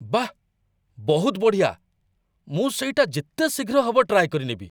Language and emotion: Odia, surprised